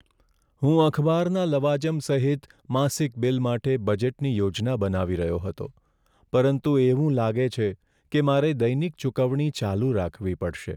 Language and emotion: Gujarati, sad